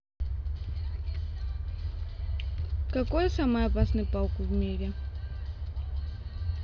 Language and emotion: Russian, neutral